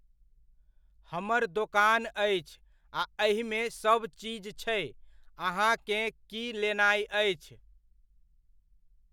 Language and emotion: Maithili, neutral